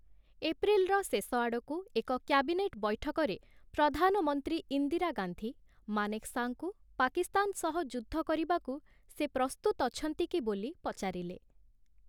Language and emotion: Odia, neutral